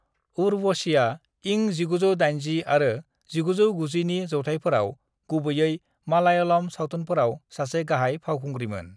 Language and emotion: Bodo, neutral